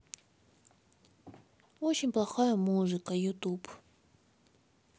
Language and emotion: Russian, sad